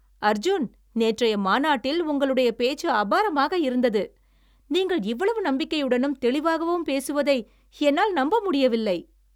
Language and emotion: Tamil, happy